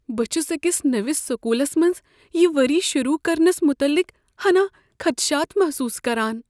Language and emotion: Kashmiri, fearful